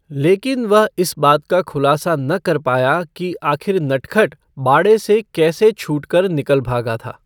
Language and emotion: Hindi, neutral